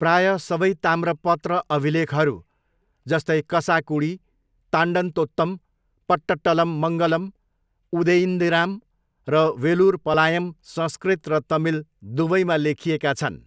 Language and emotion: Nepali, neutral